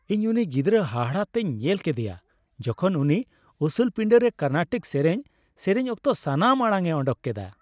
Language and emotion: Santali, happy